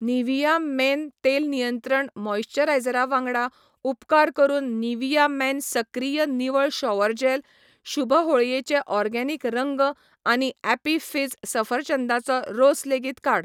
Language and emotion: Goan Konkani, neutral